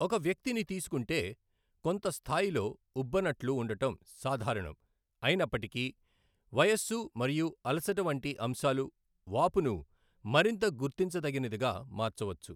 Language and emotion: Telugu, neutral